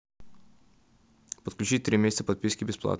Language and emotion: Russian, neutral